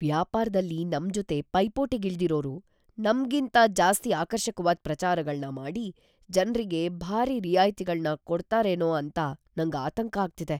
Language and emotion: Kannada, fearful